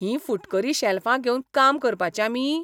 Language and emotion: Goan Konkani, disgusted